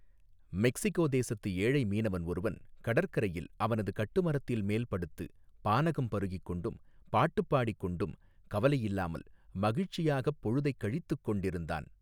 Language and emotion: Tamil, neutral